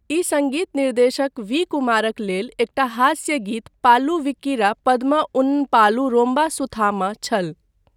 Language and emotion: Maithili, neutral